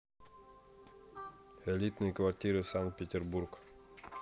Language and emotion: Russian, neutral